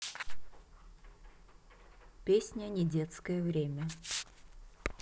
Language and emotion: Russian, neutral